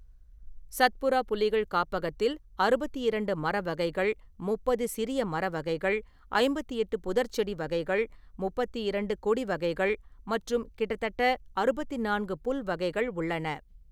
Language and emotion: Tamil, neutral